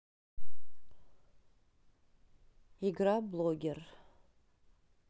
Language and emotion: Russian, neutral